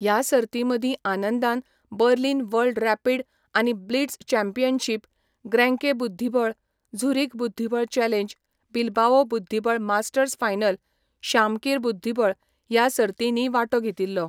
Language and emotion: Goan Konkani, neutral